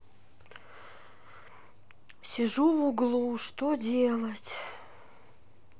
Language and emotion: Russian, sad